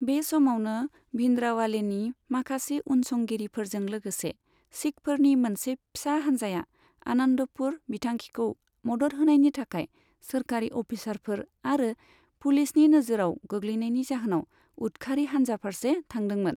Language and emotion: Bodo, neutral